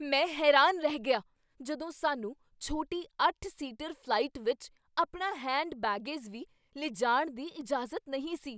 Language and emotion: Punjabi, surprised